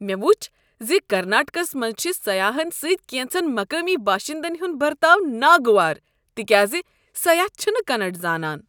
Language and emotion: Kashmiri, disgusted